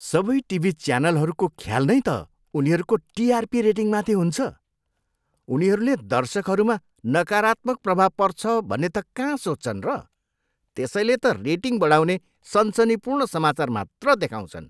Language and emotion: Nepali, disgusted